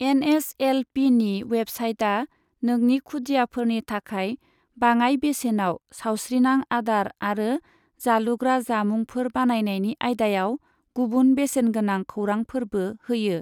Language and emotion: Bodo, neutral